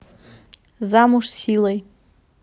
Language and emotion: Russian, neutral